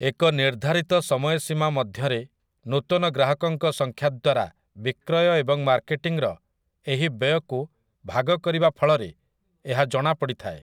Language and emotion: Odia, neutral